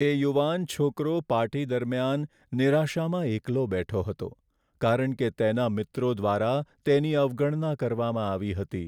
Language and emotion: Gujarati, sad